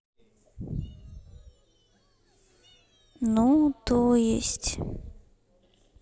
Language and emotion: Russian, sad